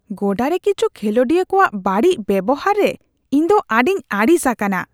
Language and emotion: Santali, disgusted